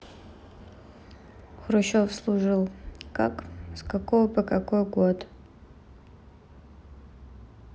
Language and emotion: Russian, neutral